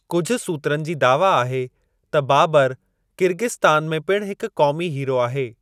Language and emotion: Sindhi, neutral